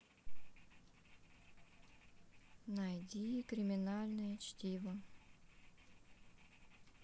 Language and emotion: Russian, neutral